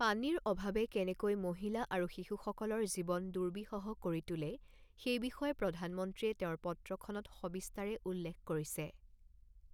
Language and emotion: Assamese, neutral